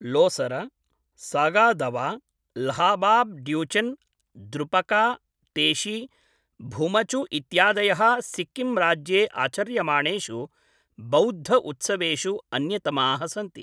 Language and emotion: Sanskrit, neutral